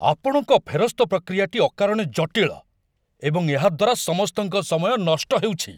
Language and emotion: Odia, angry